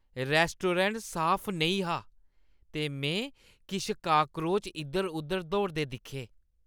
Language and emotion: Dogri, disgusted